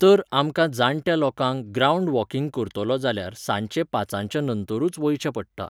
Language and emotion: Goan Konkani, neutral